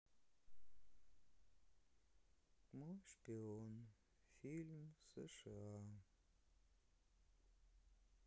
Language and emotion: Russian, sad